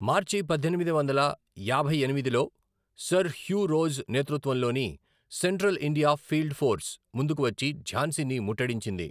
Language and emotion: Telugu, neutral